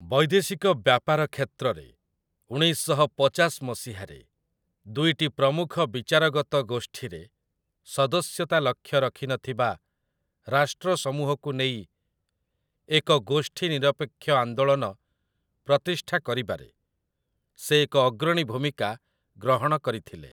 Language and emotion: Odia, neutral